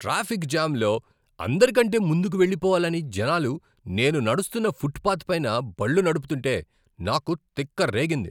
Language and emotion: Telugu, angry